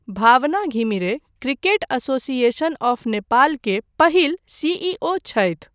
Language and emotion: Maithili, neutral